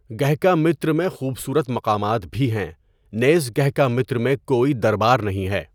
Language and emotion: Urdu, neutral